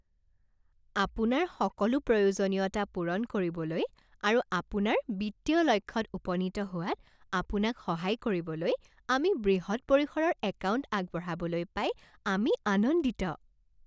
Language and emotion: Assamese, happy